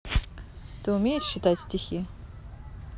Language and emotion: Russian, neutral